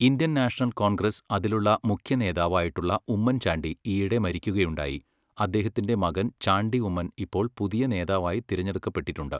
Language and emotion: Malayalam, neutral